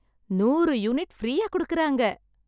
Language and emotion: Tamil, happy